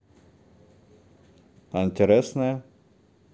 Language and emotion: Russian, neutral